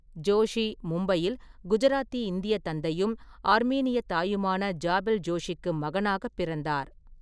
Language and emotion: Tamil, neutral